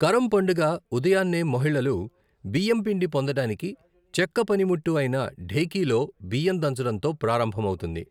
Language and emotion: Telugu, neutral